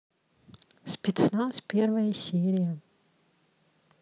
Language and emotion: Russian, neutral